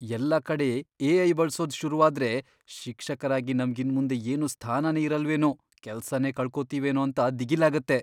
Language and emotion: Kannada, fearful